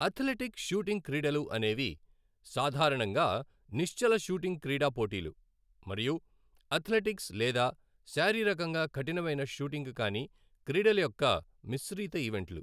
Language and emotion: Telugu, neutral